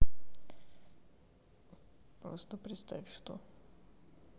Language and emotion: Russian, sad